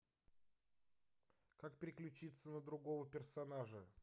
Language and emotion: Russian, neutral